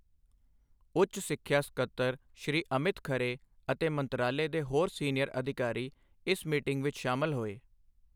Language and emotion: Punjabi, neutral